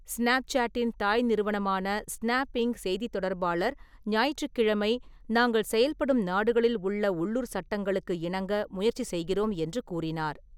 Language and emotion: Tamil, neutral